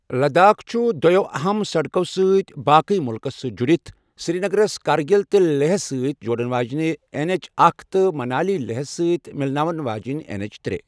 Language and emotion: Kashmiri, neutral